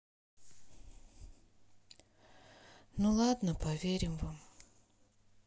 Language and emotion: Russian, sad